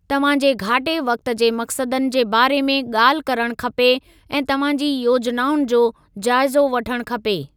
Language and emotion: Sindhi, neutral